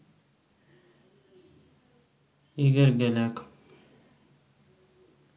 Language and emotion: Russian, neutral